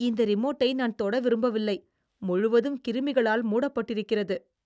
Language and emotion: Tamil, disgusted